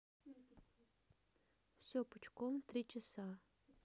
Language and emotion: Russian, neutral